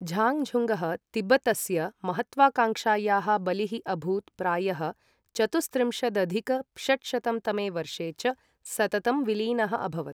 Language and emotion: Sanskrit, neutral